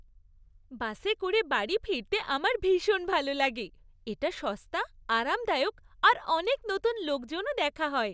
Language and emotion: Bengali, happy